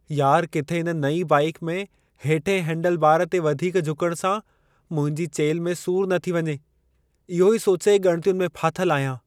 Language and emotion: Sindhi, fearful